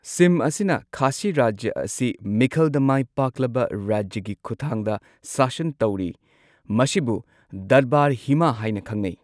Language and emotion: Manipuri, neutral